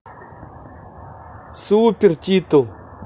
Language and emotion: Russian, positive